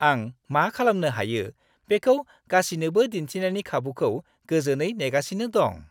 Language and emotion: Bodo, happy